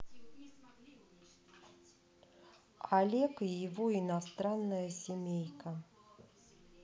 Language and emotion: Russian, neutral